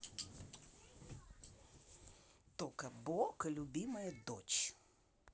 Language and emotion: Russian, neutral